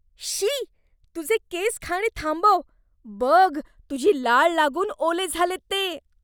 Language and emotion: Marathi, disgusted